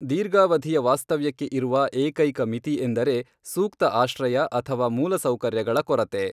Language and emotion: Kannada, neutral